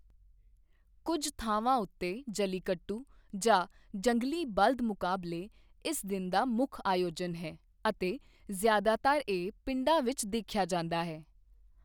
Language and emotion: Punjabi, neutral